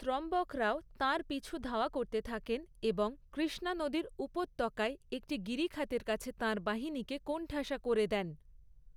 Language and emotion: Bengali, neutral